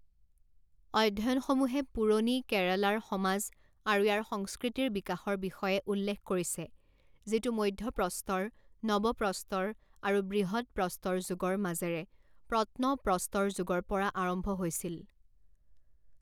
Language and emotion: Assamese, neutral